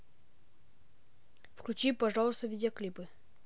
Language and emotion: Russian, neutral